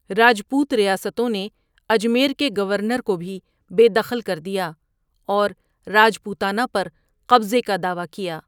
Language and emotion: Urdu, neutral